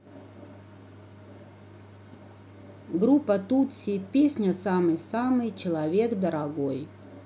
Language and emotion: Russian, neutral